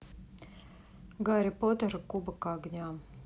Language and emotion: Russian, neutral